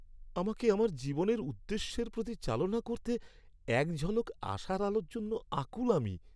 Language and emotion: Bengali, sad